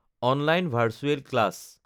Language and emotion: Assamese, neutral